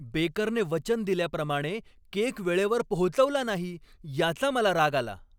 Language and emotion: Marathi, angry